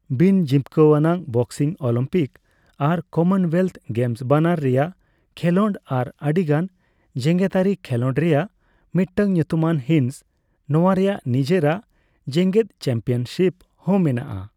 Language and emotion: Santali, neutral